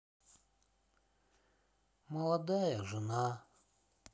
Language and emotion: Russian, sad